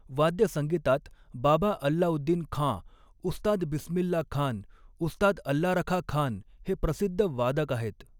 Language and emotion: Marathi, neutral